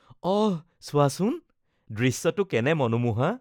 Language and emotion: Assamese, happy